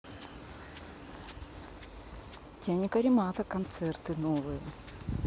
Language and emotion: Russian, neutral